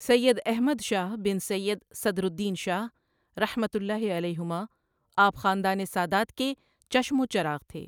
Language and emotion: Urdu, neutral